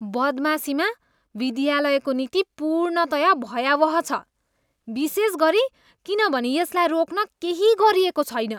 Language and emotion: Nepali, disgusted